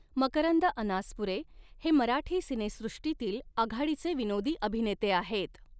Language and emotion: Marathi, neutral